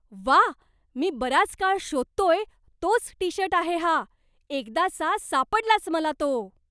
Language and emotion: Marathi, surprised